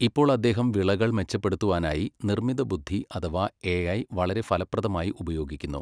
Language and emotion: Malayalam, neutral